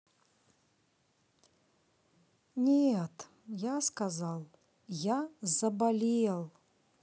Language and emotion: Russian, sad